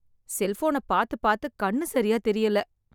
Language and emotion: Tamil, sad